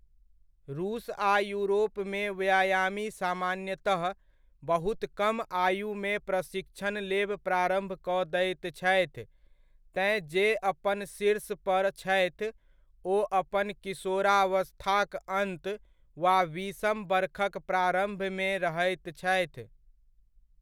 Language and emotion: Maithili, neutral